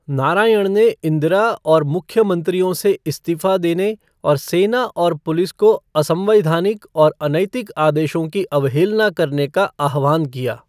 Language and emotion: Hindi, neutral